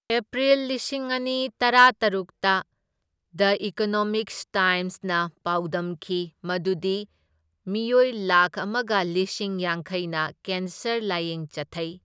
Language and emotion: Manipuri, neutral